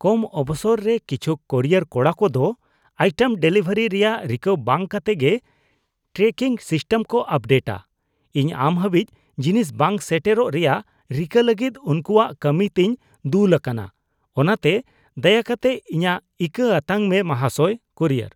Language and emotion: Santali, disgusted